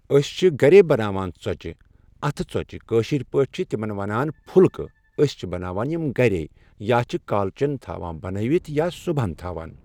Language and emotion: Kashmiri, neutral